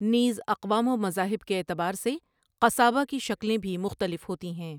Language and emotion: Urdu, neutral